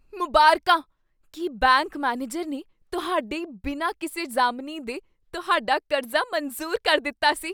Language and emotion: Punjabi, surprised